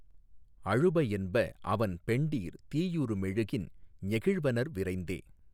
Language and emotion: Tamil, neutral